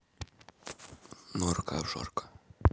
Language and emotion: Russian, neutral